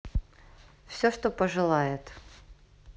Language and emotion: Russian, neutral